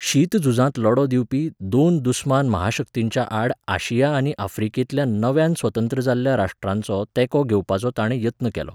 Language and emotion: Goan Konkani, neutral